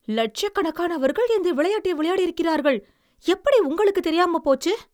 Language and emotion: Tamil, surprised